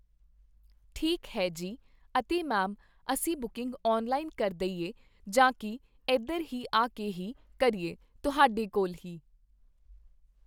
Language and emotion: Punjabi, neutral